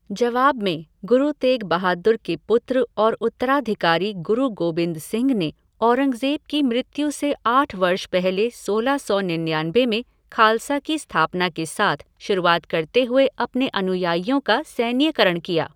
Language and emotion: Hindi, neutral